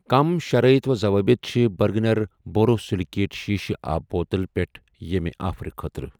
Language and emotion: Kashmiri, neutral